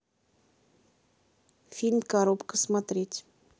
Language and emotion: Russian, neutral